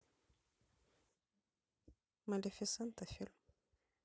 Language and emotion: Russian, neutral